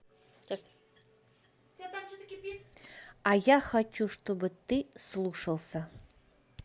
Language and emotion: Russian, neutral